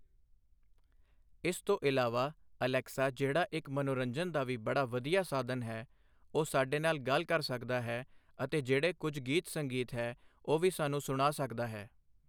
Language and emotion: Punjabi, neutral